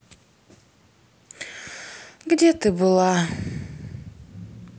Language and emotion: Russian, sad